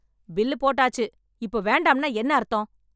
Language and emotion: Tamil, angry